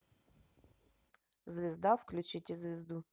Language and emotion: Russian, neutral